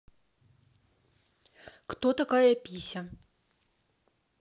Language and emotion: Russian, neutral